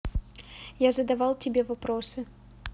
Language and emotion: Russian, neutral